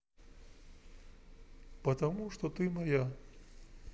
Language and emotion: Russian, neutral